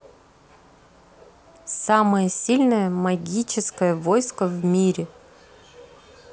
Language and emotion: Russian, neutral